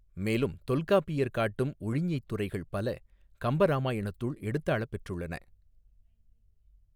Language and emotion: Tamil, neutral